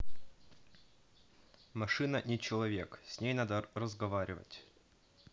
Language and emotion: Russian, neutral